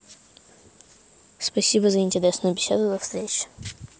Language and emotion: Russian, neutral